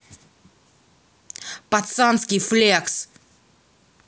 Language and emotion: Russian, angry